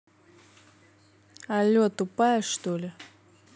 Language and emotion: Russian, angry